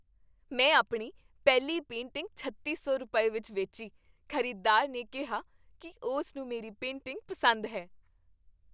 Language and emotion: Punjabi, happy